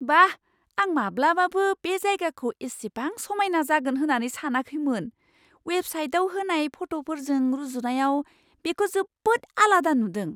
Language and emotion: Bodo, surprised